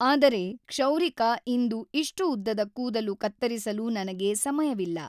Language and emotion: Kannada, neutral